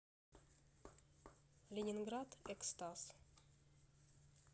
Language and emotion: Russian, neutral